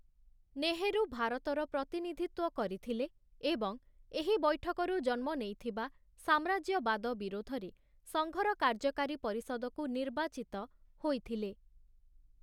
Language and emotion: Odia, neutral